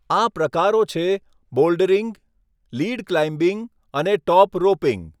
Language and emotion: Gujarati, neutral